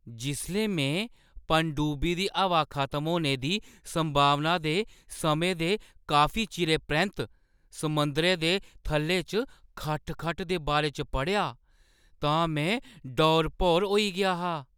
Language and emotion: Dogri, surprised